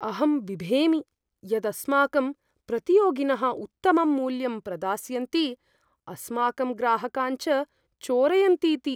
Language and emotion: Sanskrit, fearful